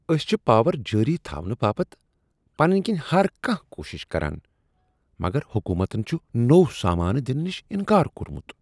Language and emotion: Kashmiri, disgusted